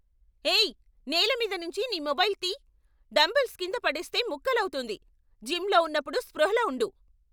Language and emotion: Telugu, angry